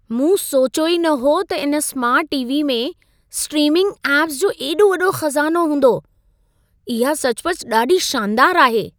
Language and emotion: Sindhi, surprised